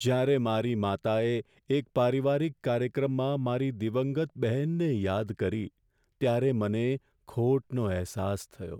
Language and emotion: Gujarati, sad